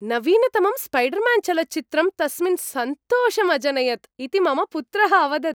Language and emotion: Sanskrit, happy